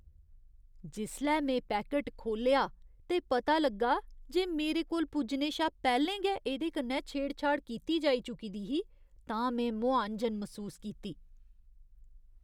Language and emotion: Dogri, disgusted